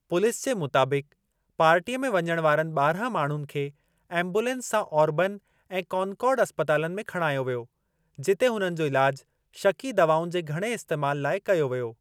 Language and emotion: Sindhi, neutral